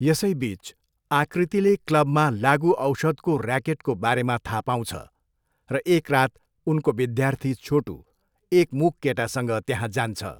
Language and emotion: Nepali, neutral